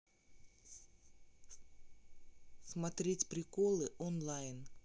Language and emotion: Russian, neutral